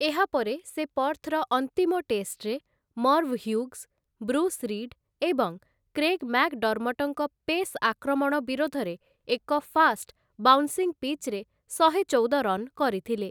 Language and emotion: Odia, neutral